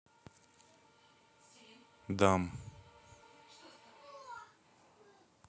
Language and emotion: Russian, neutral